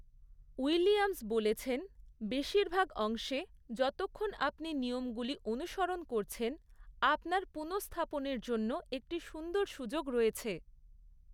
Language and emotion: Bengali, neutral